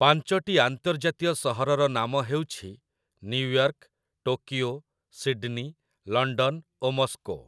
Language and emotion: Odia, neutral